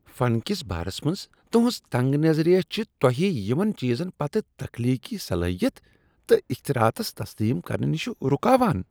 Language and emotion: Kashmiri, disgusted